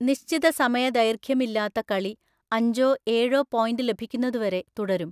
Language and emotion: Malayalam, neutral